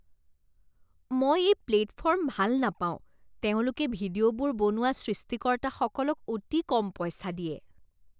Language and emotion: Assamese, disgusted